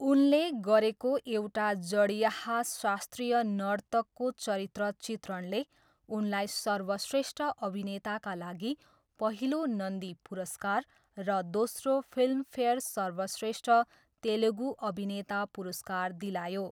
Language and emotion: Nepali, neutral